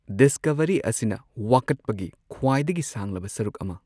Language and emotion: Manipuri, neutral